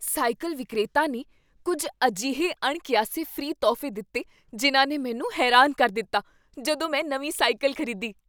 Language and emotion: Punjabi, surprised